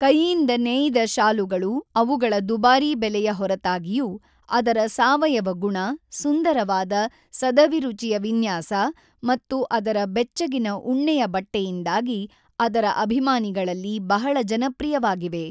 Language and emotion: Kannada, neutral